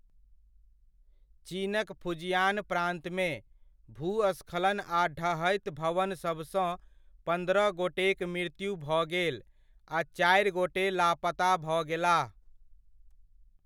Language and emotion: Maithili, neutral